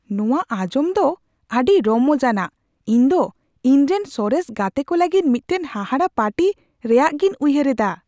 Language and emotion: Santali, surprised